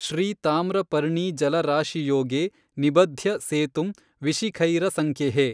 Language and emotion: Kannada, neutral